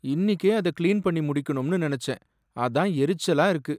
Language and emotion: Tamil, sad